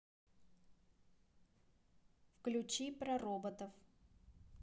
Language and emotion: Russian, neutral